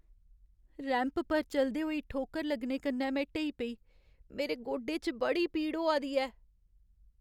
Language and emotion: Dogri, sad